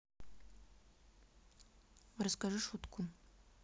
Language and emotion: Russian, neutral